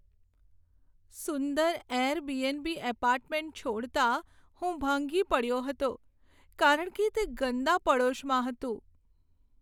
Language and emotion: Gujarati, sad